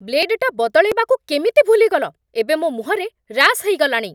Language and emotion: Odia, angry